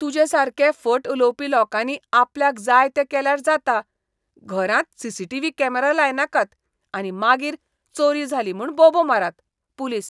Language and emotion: Goan Konkani, disgusted